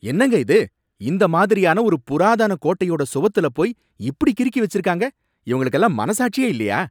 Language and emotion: Tamil, angry